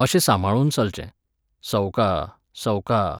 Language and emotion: Goan Konkani, neutral